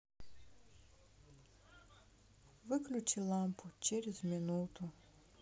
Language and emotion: Russian, sad